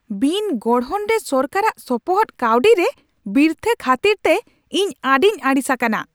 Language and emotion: Santali, angry